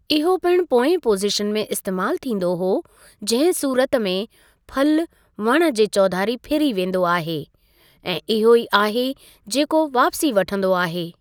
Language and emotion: Sindhi, neutral